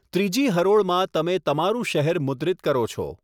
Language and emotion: Gujarati, neutral